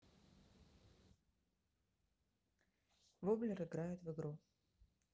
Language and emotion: Russian, neutral